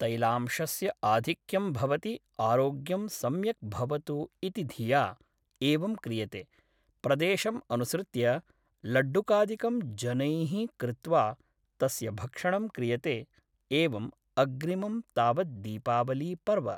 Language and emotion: Sanskrit, neutral